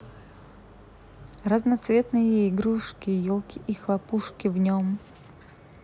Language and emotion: Russian, neutral